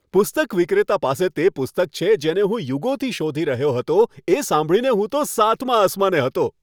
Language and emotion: Gujarati, happy